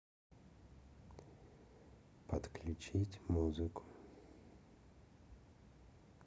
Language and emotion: Russian, neutral